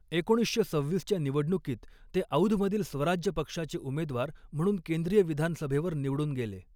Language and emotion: Marathi, neutral